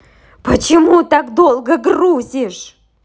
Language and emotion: Russian, angry